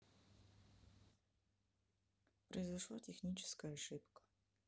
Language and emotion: Russian, sad